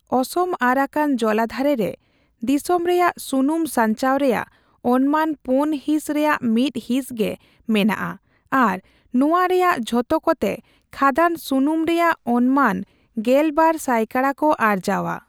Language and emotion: Santali, neutral